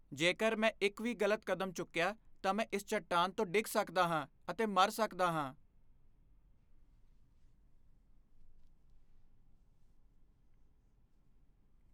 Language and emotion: Punjabi, fearful